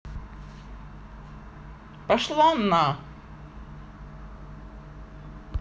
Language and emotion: Russian, angry